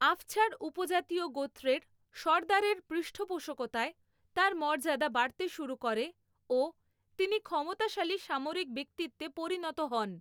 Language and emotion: Bengali, neutral